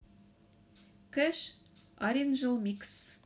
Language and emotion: Russian, neutral